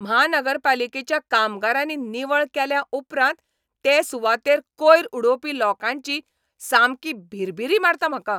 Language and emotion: Goan Konkani, angry